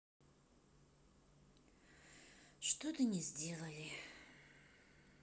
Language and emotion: Russian, sad